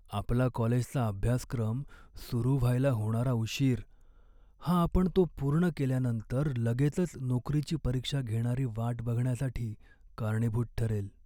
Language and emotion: Marathi, sad